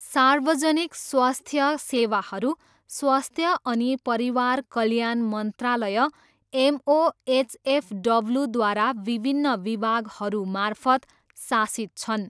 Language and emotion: Nepali, neutral